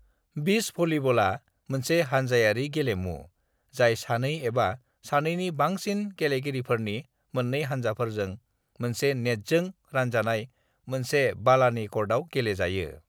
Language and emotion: Bodo, neutral